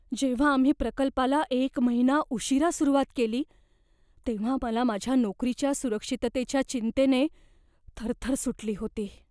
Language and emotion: Marathi, fearful